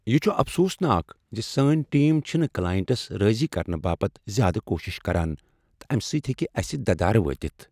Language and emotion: Kashmiri, sad